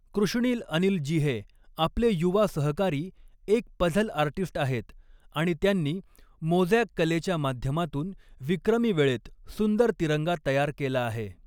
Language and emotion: Marathi, neutral